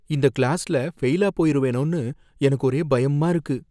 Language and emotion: Tamil, fearful